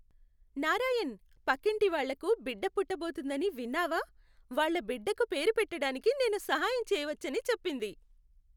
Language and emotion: Telugu, happy